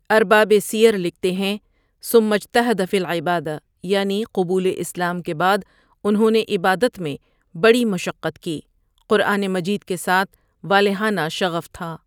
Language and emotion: Urdu, neutral